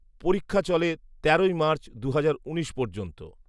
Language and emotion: Bengali, neutral